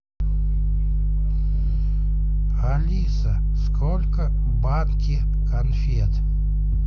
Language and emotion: Russian, neutral